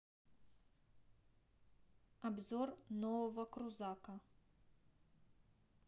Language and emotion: Russian, neutral